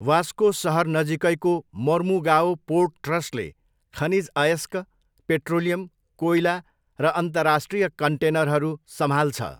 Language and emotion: Nepali, neutral